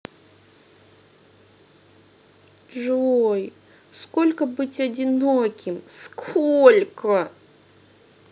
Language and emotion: Russian, sad